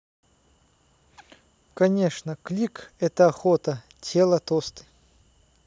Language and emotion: Russian, neutral